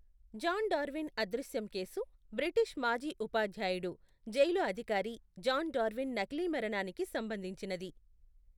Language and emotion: Telugu, neutral